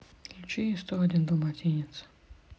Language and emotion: Russian, sad